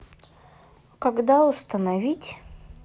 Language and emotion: Russian, neutral